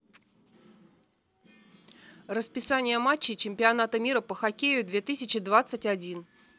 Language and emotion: Russian, neutral